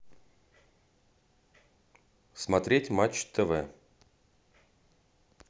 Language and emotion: Russian, neutral